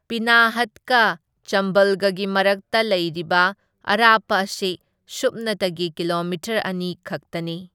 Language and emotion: Manipuri, neutral